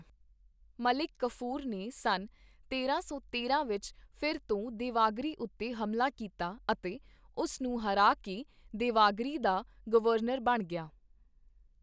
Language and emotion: Punjabi, neutral